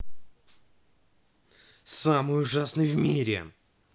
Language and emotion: Russian, angry